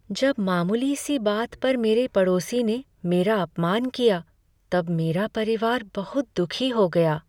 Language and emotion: Hindi, sad